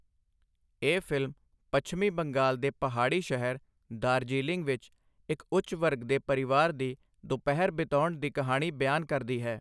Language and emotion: Punjabi, neutral